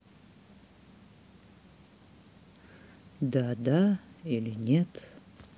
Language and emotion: Russian, sad